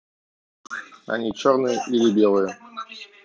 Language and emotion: Russian, neutral